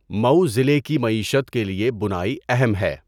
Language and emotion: Urdu, neutral